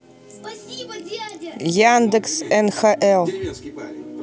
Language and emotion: Russian, neutral